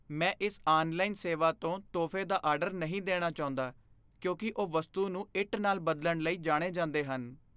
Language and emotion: Punjabi, fearful